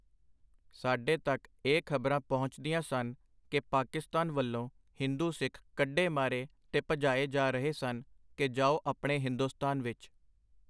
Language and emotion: Punjabi, neutral